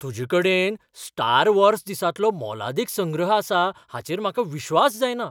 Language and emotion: Goan Konkani, surprised